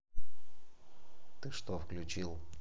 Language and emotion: Russian, neutral